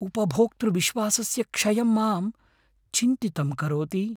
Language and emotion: Sanskrit, fearful